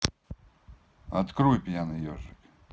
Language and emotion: Russian, neutral